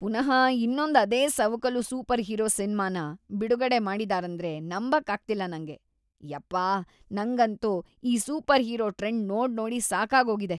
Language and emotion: Kannada, disgusted